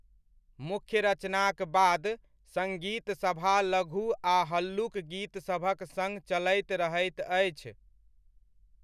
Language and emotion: Maithili, neutral